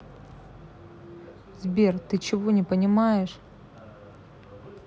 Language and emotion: Russian, neutral